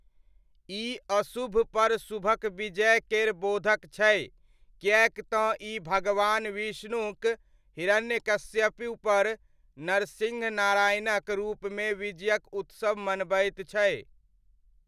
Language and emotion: Maithili, neutral